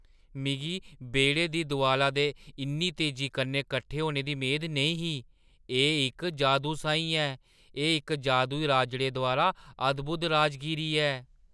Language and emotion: Dogri, surprised